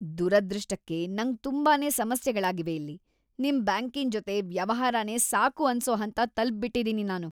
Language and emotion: Kannada, disgusted